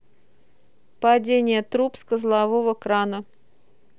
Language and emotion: Russian, neutral